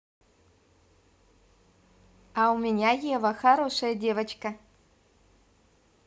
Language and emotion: Russian, positive